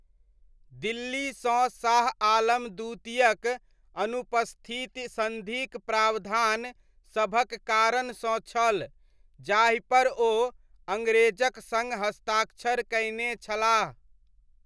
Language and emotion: Maithili, neutral